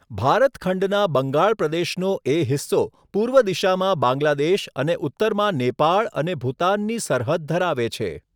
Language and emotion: Gujarati, neutral